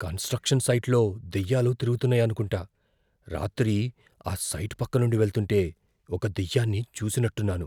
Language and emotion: Telugu, fearful